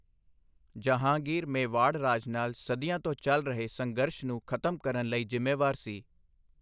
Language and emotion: Punjabi, neutral